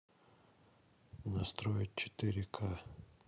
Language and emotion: Russian, neutral